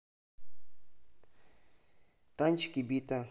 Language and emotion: Russian, neutral